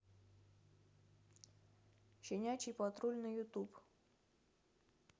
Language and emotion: Russian, neutral